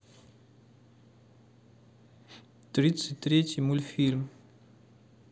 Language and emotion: Russian, neutral